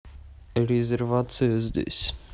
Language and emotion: Russian, neutral